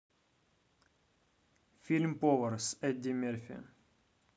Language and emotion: Russian, neutral